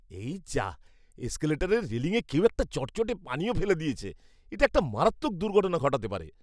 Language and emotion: Bengali, disgusted